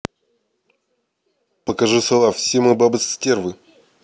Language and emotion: Russian, neutral